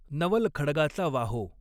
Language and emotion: Marathi, neutral